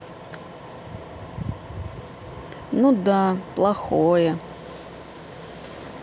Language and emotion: Russian, sad